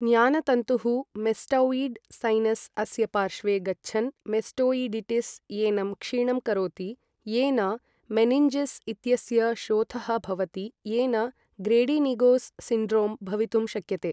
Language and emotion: Sanskrit, neutral